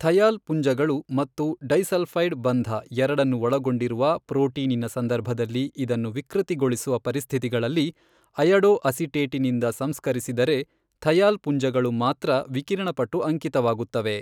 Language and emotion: Kannada, neutral